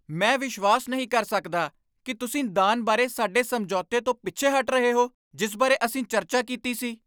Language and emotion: Punjabi, angry